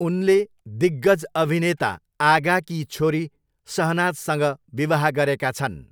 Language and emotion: Nepali, neutral